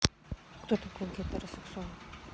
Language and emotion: Russian, neutral